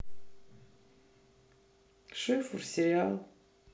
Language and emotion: Russian, neutral